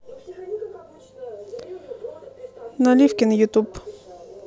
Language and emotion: Russian, neutral